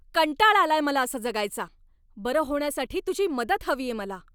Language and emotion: Marathi, angry